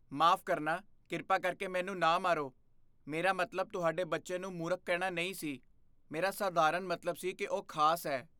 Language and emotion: Punjabi, fearful